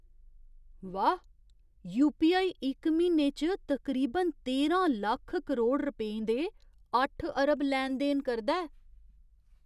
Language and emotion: Dogri, surprised